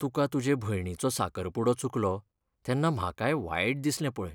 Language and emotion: Goan Konkani, sad